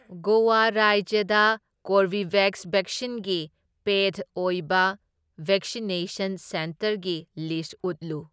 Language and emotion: Manipuri, neutral